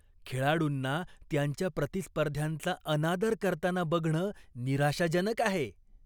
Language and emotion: Marathi, disgusted